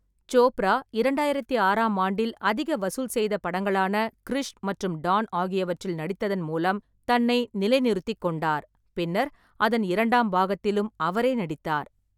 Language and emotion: Tamil, neutral